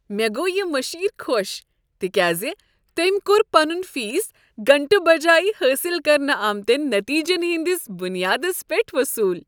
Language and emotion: Kashmiri, happy